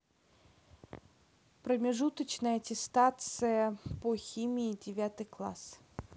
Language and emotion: Russian, neutral